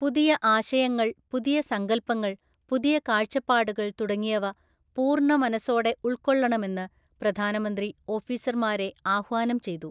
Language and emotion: Malayalam, neutral